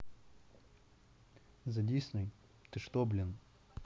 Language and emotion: Russian, neutral